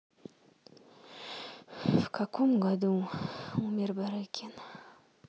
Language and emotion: Russian, neutral